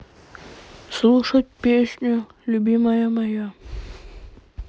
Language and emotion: Russian, sad